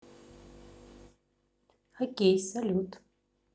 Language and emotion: Russian, neutral